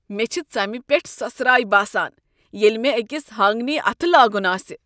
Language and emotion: Kashmiri, disgusted